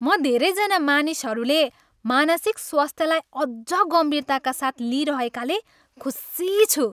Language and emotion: Nepali, happy